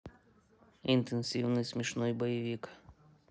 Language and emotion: Russian, neutral